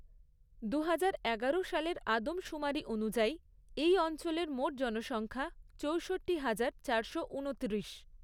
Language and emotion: Bengali, neutral